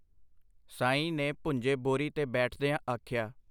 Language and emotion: Punjabi, neutral